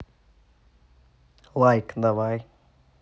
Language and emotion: Russian, neutral